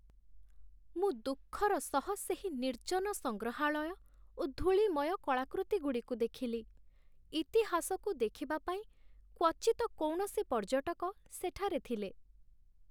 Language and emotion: Odia, sad